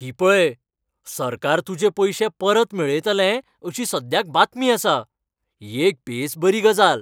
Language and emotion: Goan Konkani, happy